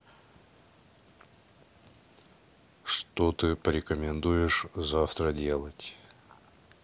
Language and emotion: Russian, neutral